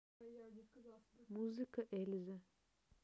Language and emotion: Russian, neutral